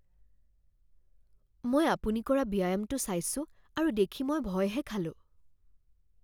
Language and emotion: Assamese, fearful